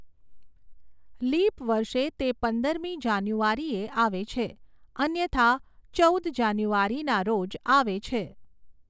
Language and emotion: Gujarati, neutral